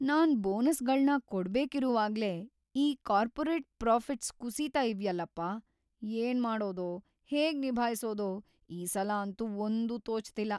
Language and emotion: Kannada, fearful